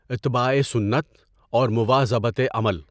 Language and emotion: Urdu, neutral